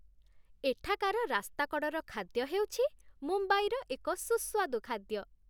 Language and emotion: Odia, happy